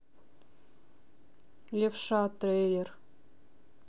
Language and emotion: Russian, neutral